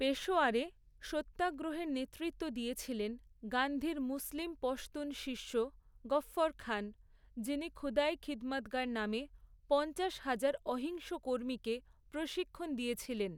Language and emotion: Bengali, neutral